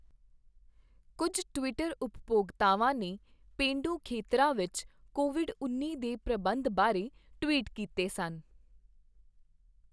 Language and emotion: Punjabi, neutral